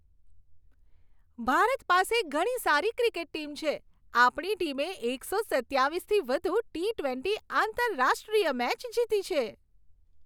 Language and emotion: Gujarati, happy